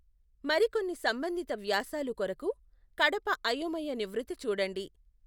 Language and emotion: Telugu, neutral